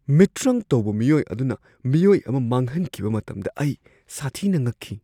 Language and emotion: Manipuri, surprised